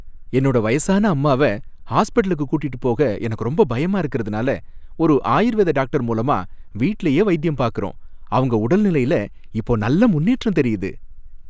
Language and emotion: Tamil, happy